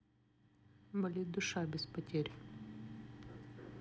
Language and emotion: Russian, neutral